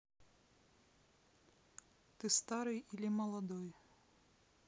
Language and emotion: Russian, neutral